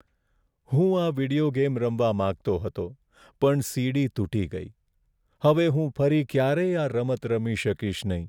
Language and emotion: Gujarati, sad